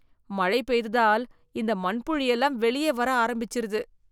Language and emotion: Tamil, disgusted